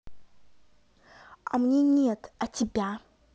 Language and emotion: Russian, neutral